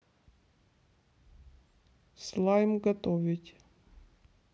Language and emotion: Russian, neutral